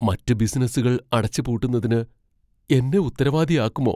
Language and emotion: Malayalam, fearful